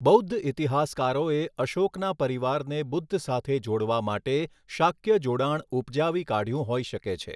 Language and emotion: Gujarati, neutral